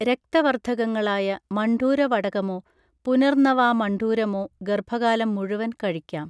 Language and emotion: Malayalam, neutral